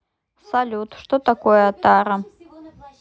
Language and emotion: Russian, neutral